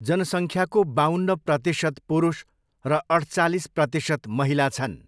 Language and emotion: Nepali, neutral